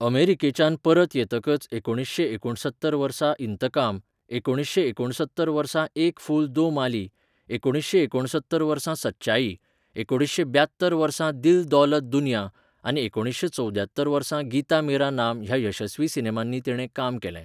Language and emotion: Goan Konkani, neutral